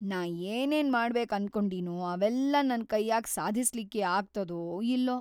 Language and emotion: Kannada, fearful